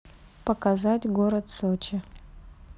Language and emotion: Russian, neutral